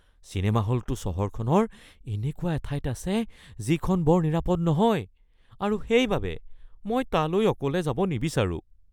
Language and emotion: Assamese, fearful